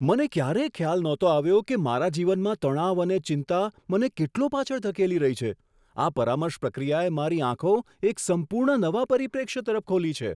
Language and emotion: Gujarati, surprised